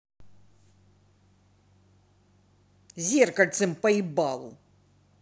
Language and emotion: Russian, angry